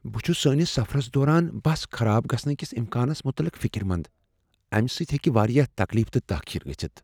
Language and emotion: Kashmiri, fearful